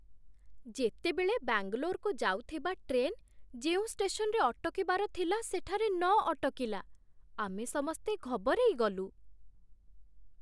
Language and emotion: Odia, surprised